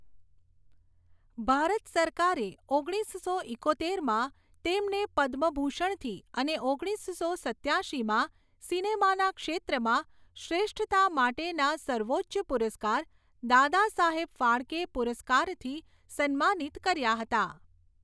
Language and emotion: Gujarati, neutral